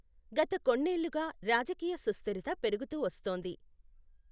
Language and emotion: Telugu, neutral